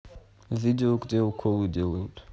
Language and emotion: Russian, neutral